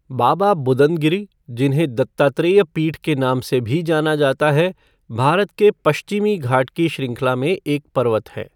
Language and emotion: Hindi, neutral